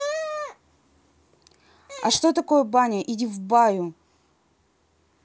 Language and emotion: Russian, angry